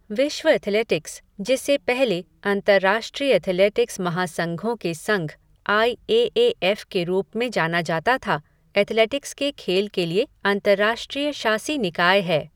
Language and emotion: Hindi, neutral